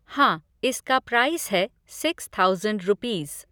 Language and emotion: Hindi, neutral